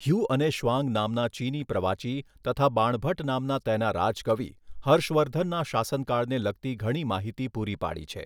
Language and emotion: Gujarati, neutral